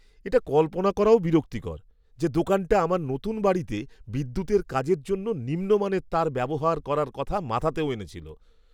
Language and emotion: Bengali, disgusted